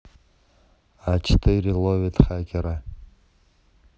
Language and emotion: Russian, neutral